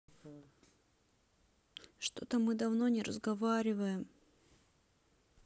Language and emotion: Russian, sad